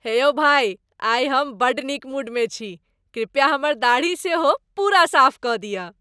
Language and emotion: Maithili, happy